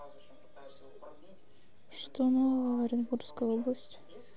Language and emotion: Russian, neutral